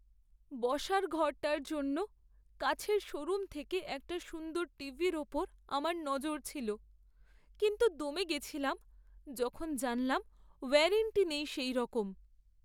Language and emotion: Bengali, sad